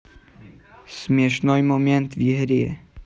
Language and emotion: Russian, neutral